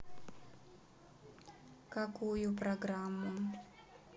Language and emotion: Russian, neutral